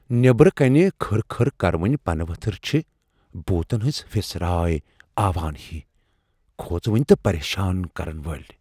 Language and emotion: Kashmiri, fearful